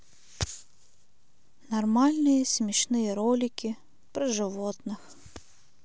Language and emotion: Russian, neutral